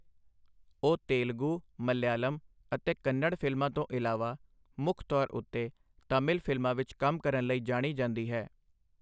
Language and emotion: Punjabi, neutral